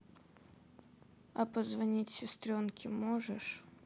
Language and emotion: Russian, sad